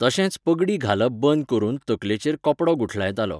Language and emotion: Goan Konkani, neutral